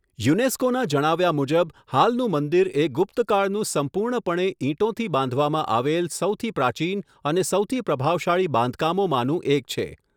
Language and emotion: Gujarati, neutral